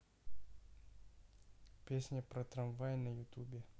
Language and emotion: Russian, neutral